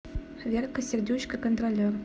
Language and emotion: Russian, neutral